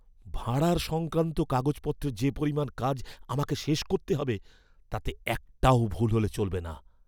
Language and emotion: Bengali, fearful